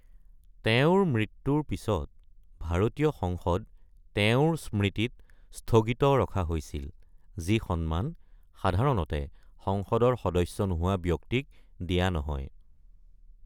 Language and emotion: Assamese, neutral